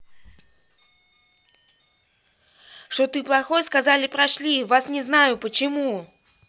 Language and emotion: Russian, angry